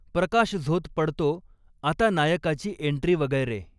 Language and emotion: Marathi, neutral